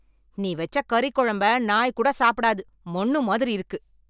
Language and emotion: Tamil, angry